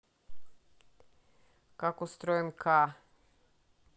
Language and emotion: Russian, neutral